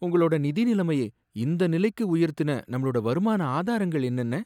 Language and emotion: Tamil, sad